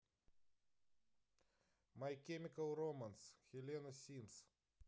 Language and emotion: Russian, neutral